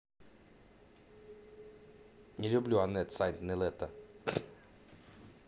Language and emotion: Russian, neutral